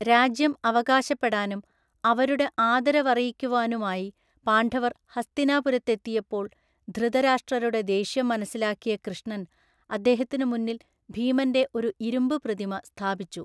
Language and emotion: Malayalam, neutral